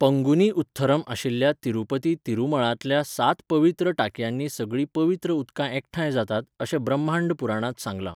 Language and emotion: Goan Konkani, neutral